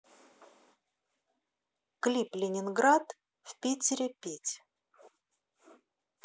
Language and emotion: Russian, neutral